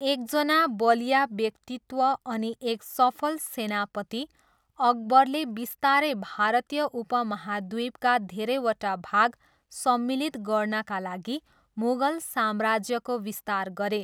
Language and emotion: Nepali, neutral